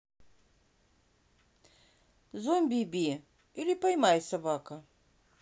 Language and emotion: Russian, neutral